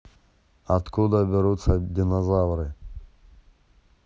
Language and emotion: Russian, neutral